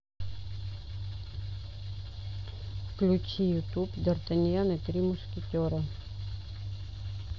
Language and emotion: Russian, neutral